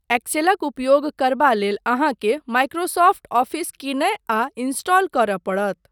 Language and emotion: Maithili, neutral